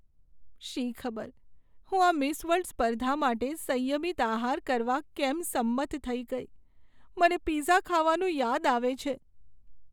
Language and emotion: Gujarati, sad